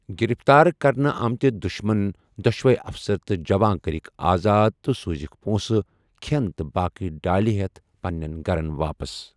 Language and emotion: Kashmiri, neutral